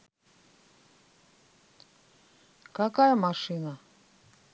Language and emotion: Russian, neutral